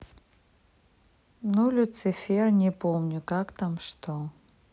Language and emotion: Russian, neutral